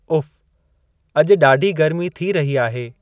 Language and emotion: Sindhi, neutral